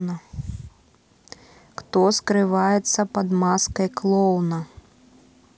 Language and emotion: Russian, neutral